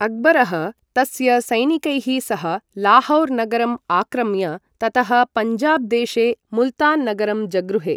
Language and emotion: Sanskrit, neutral